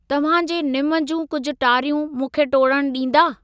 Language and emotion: Sindhi, neutral